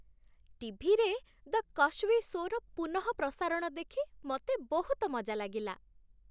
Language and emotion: Odia, happy